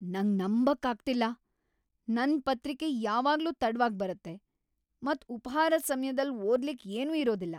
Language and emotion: Kannada, angry